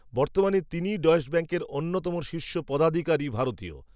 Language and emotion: Bengali, neutral